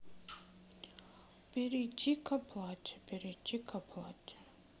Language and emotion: Russian, sad